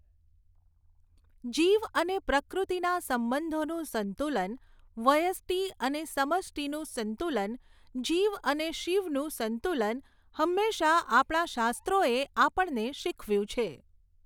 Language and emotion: Gujarati, neutral